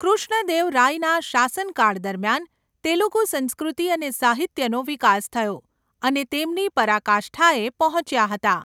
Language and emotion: Gujarati, neutral